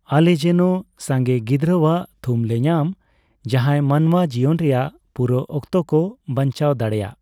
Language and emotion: Santali, neutral